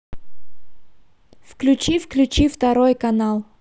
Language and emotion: Russian, neutral